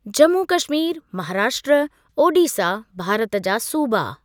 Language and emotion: Sindhi, neutral